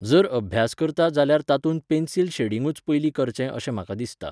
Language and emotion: Goan Konkani, neutral